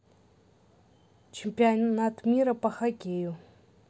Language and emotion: Russian, neutral